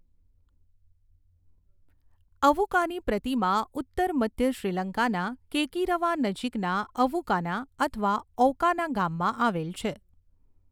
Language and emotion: Gujarati, neutral